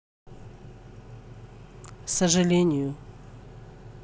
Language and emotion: Russian, sad